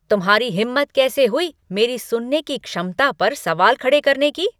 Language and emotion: Hindi, angry